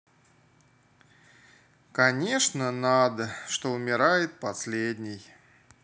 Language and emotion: Russian, sad